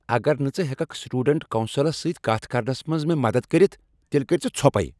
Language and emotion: Kashmiri, angry